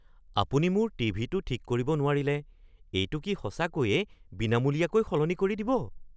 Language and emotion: Assamese, surprised